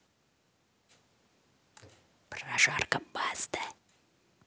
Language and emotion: Russian, neutral